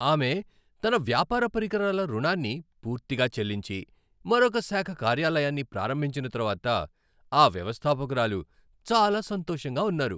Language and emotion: Telugu, happy